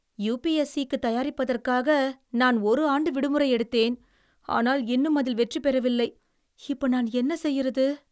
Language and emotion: Tamil, sad